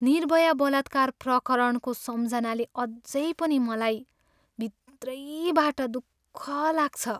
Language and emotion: Nepali, sad